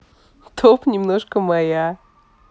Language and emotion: Russian, positive